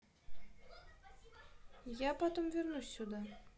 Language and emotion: Russian, neutral